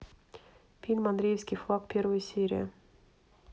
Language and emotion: Russian, neutral